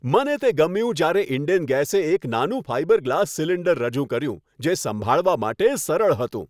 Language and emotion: Gujarati, happy